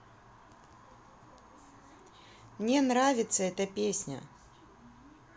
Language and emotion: Russian, neutral